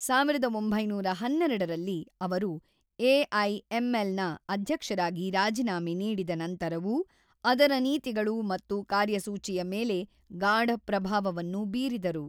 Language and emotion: Kannada, neutral